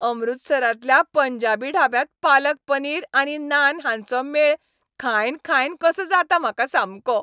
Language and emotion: Goan Konkani, happy